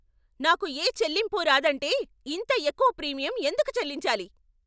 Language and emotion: Telugu, angry